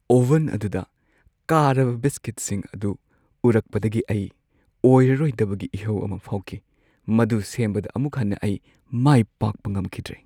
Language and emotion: Manipuri, sad